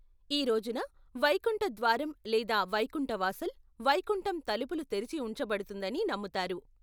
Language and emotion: Telugu, neutral